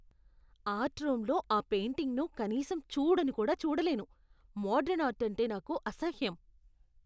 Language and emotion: Telugu, disgusted